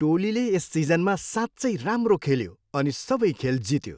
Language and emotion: Nepali, happy